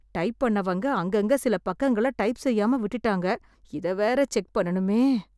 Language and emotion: Tamil, fearful